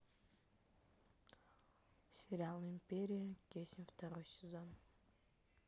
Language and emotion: Russian, neutral